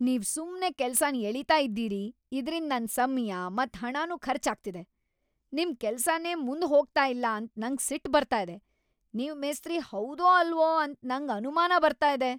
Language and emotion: Kannada, angry